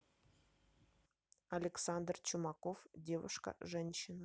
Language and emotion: Russian, neutral